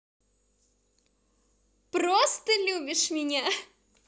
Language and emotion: Russian, positive